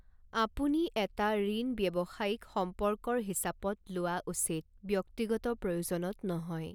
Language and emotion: Assamese, neutral